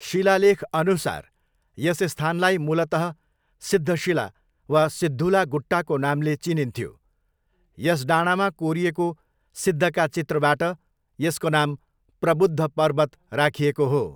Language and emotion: Nepali, neutral